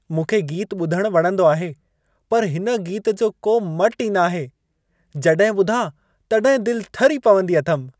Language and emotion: Sindhi, happy